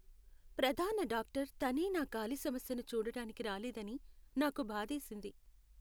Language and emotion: Telugu, sad